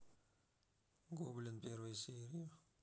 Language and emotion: Russian, neutral